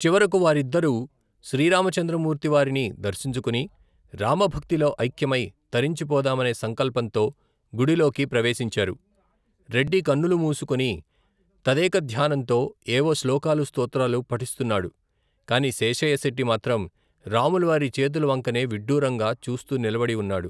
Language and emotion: Telugu, neutral